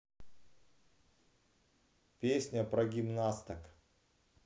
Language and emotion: Russian, neutral